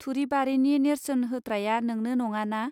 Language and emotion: Bodo, neutral